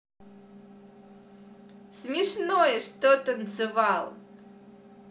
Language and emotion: Russian, positive